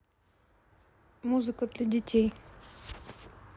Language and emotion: Russian, neutral